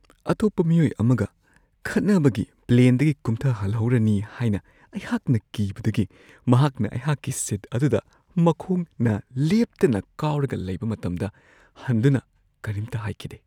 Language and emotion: Manipuri, fearful